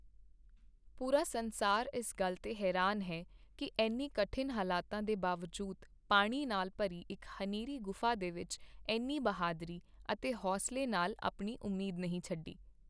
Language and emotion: Punjabi, neutral